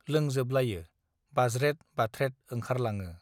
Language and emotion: Bodo, neutral